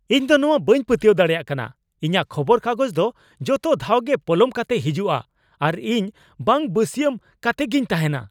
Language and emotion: Santali, angry